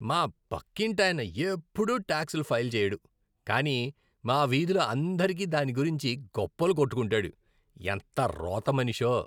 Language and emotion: Telugu, disgusted